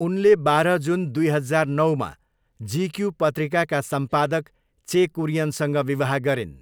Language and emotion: Nepali, neutral